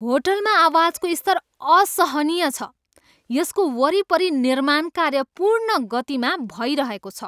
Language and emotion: Nepali, angry